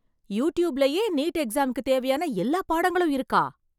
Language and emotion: Tamil, surprised